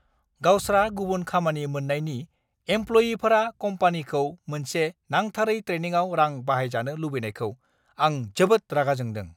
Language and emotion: Bodo, angry